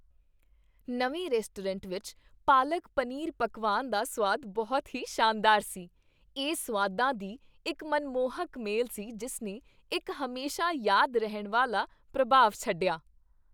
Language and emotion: Punjabi, happy